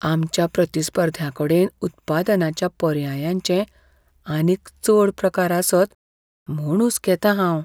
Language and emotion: Goan Konkani, fearful